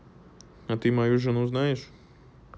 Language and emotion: Russian, neutral